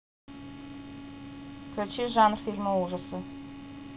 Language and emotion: Russian, neutral